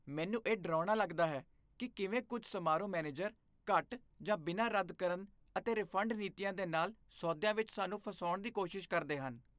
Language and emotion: Punjabi, disgusted